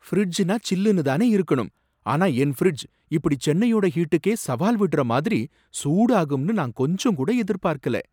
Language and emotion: Tamil, surprised